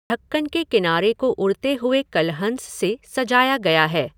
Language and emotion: Hindi, neutral